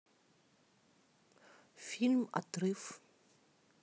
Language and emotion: Russian, neutral